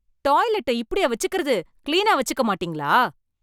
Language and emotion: Tamil, angry